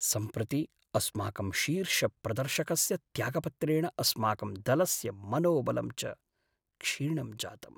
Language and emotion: Sanskrit, sad